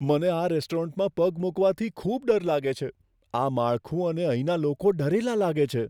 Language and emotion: Gujarati, fearful